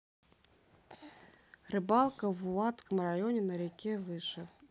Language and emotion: Russian, neutral